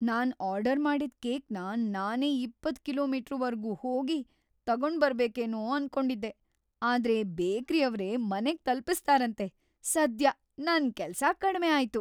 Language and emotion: Kannada, happy